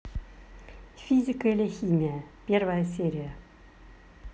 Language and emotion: Russian, neutral